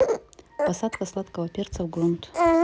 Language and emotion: Russian, neutral